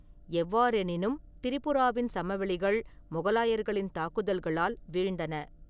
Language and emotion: Tamil, neutral